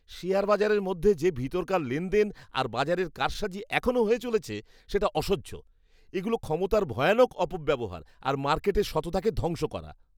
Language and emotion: Bengali, disgusted